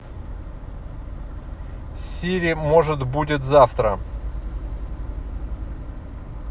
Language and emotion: Russian, neutral